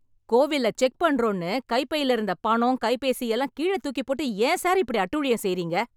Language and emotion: Tamil, angry